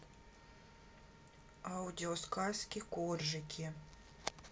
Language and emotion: Russian, neutral